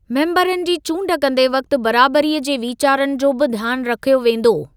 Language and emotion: Sindhi, neutral